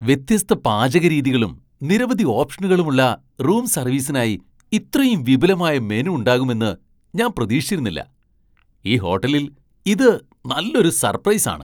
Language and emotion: Malayalam, surprised